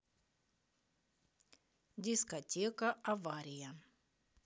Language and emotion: Russian, neutral